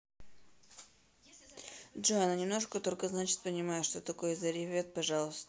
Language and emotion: Russian, neutral